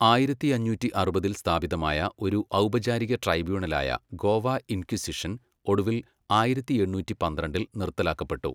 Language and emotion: Malayalam, neutral